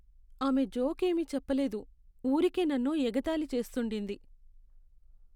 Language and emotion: Telugu, sad